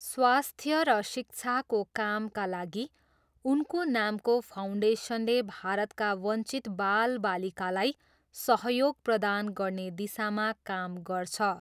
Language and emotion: Nepali, neutral